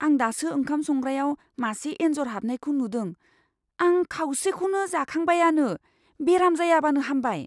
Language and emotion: Bodo, fearful